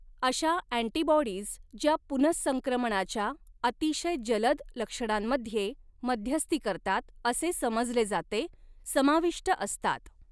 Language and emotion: Marathi, neutral